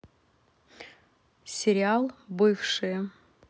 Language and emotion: Russian, neutral